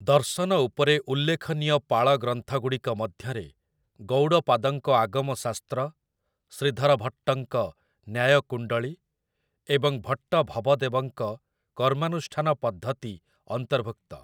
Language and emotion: Odia, neutral